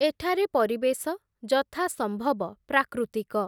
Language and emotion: Odia, neutral